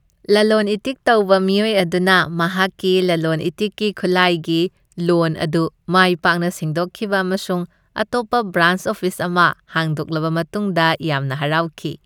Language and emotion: Manipuri, happy